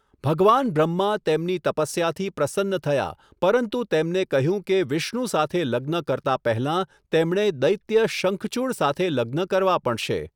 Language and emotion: Gujarati, neutral